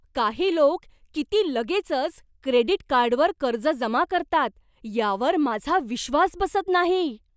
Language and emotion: Marathi, surprised